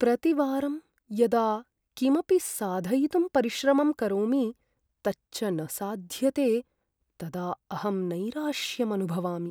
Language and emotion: Sanskrit, sad